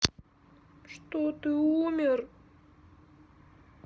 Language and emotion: Russian, sad